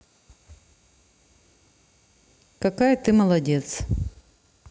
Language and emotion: Russian, neutral